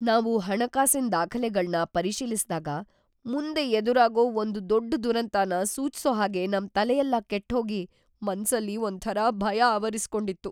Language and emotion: Kannada, fearful